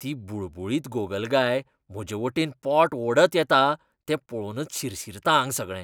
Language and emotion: Goan Konkani, disgusted